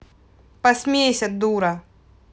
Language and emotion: Russian, angry